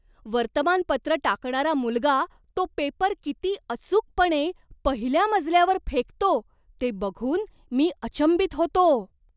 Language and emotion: Marathi, surprised